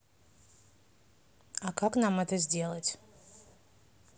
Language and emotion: Russian, neutral